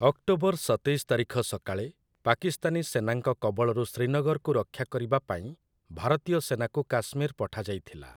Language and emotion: Odia, neutral